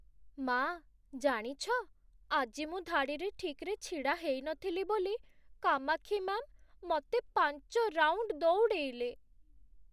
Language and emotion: Odia, sad